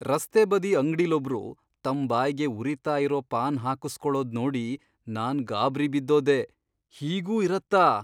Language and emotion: Kannada, surprised